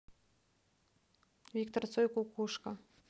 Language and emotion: Russian, neutral